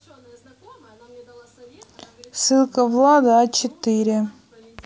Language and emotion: Russian, neutral